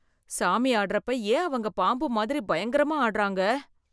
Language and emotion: Tamil, fearful